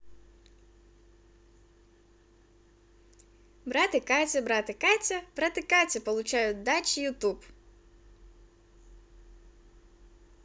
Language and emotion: Russian, positive